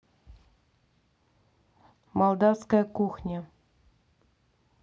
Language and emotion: Russian, neutral